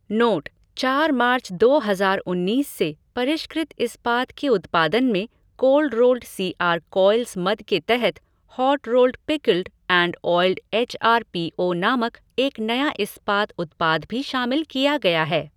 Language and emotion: Hindi, neutral